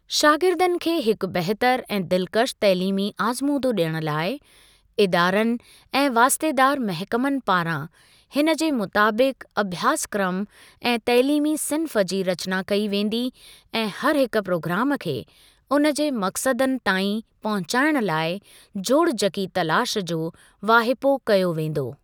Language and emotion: Sindhi, neutral